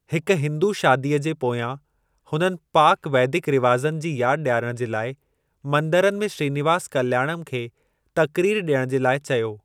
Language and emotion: Sindhi, neutral